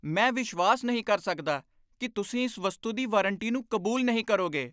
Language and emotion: Punjabi, angry